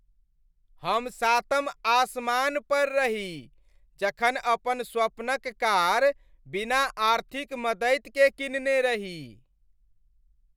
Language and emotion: Maithili, happy